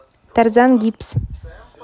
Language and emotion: Russian, neutral